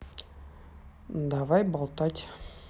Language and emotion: Russian, neutral